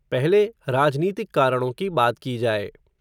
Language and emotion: Hindi, neutral